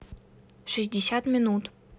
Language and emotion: Russian, neutral